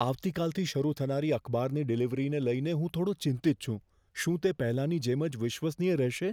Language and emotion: Gujarati, fearful